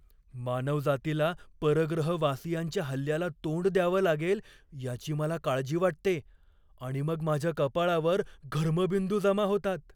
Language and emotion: Marathi, fearful